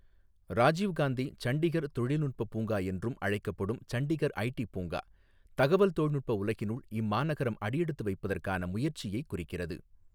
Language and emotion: Tamil, neutral